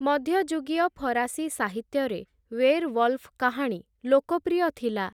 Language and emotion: Odia, neutral